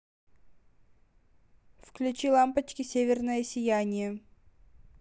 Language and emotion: Russian, neutral